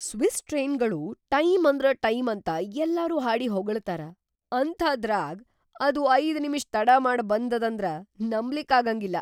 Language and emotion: Kannada, surprised